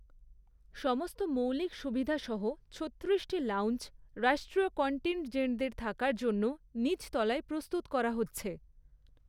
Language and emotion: Bengali, neutral